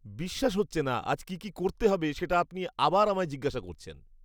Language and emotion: Bengali, disgusted